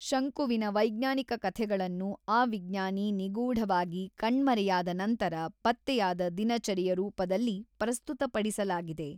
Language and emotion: Kannada, neutral